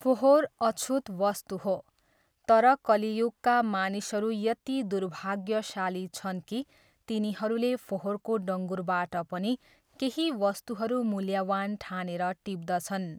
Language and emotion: Nepali, neutral